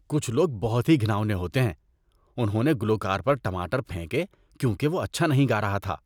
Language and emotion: Urdu, disgusted